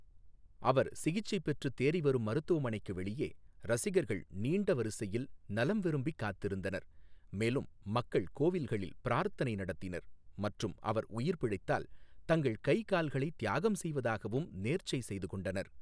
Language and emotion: Tamil, neutral